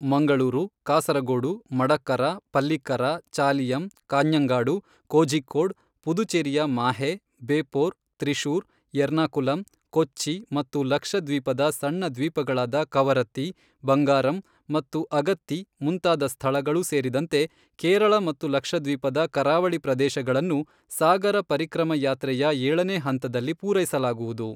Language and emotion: Kannada, neutral